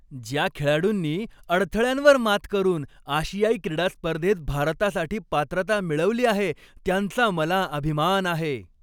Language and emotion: Marathi, happy